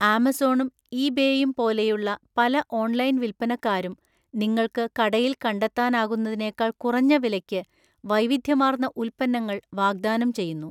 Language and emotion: Malayalam, neutral